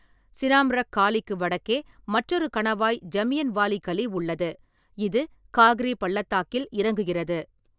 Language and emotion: Tamil, neutral